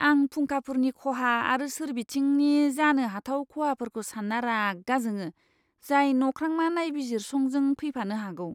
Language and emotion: Bodo, disgusted